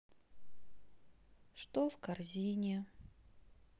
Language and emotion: Russian, sad